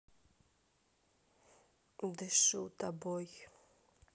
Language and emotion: Russian, sad